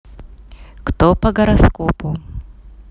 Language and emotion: Russian, neutral